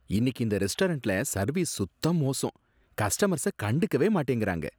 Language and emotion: Tamil, disgusted